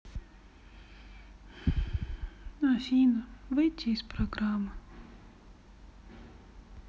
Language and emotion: Russian, sad